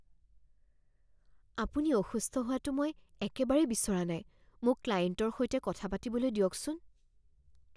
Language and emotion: Assamese, fearful